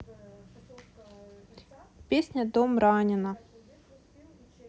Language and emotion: Russian, neutral